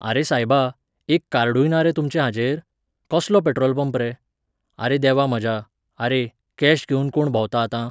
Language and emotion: Goan Konkani, neutral